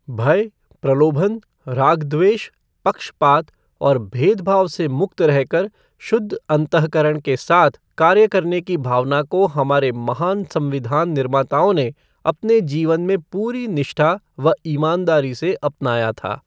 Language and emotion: Hindi, neutral